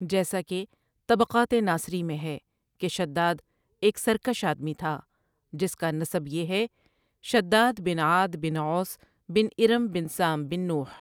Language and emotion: Urdu, neutral